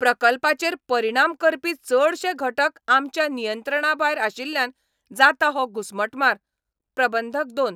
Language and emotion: Goan Konkani, angry